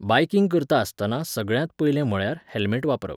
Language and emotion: Goan Konkani, neutral